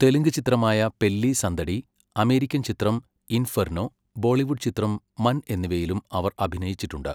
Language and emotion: Malayalam, neutral